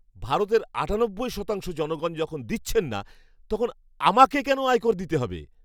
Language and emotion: Bengali, angry